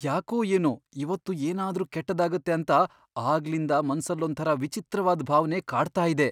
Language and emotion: Kannada, fearful